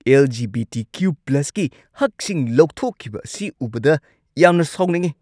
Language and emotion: Manipuri, angry